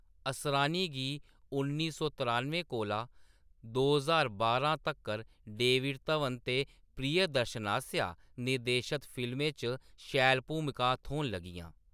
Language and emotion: Dogri, neutral